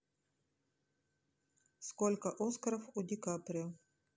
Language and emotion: Russian, neutral